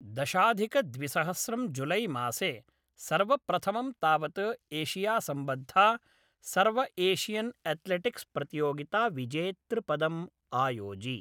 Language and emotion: Sanskrit, neutral